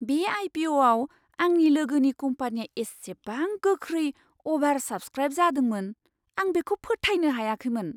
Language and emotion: Bodo, surprised